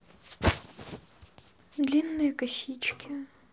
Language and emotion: Russian, neutral